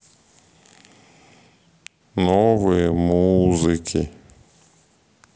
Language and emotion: Russian, sad